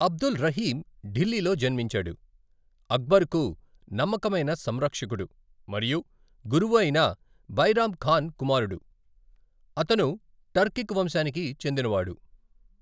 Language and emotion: Telugu, neutral